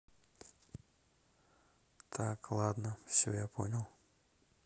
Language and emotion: Russian, neutral